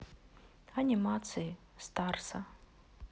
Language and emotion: Russian, neutral